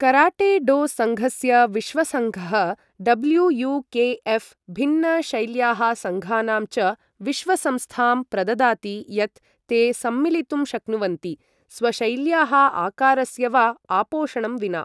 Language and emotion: Sanskrit, neutral